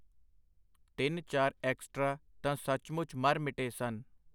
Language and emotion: Punjabi, neutral